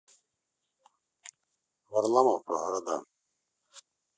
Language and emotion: Russian, neutral